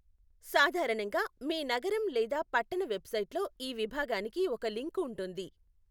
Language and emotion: Telugu, neutral